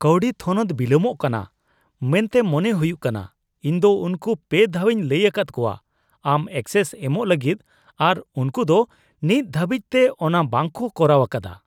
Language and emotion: Santali, disgusted